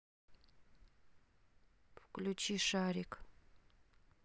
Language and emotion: Russian, neutral